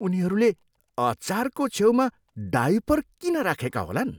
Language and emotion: Nepali, disgusted